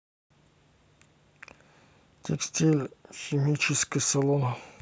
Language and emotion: Russian, neutral